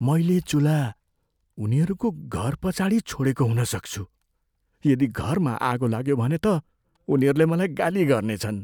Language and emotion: Nepali, fearful